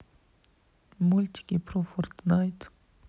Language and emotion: Russian, neutral